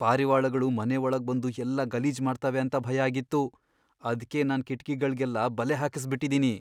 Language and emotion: Kannada, fearful